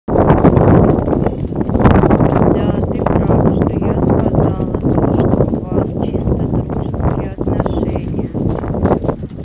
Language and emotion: Russian, neutral